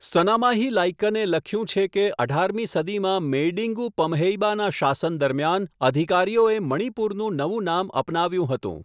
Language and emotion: Gujarati, neutral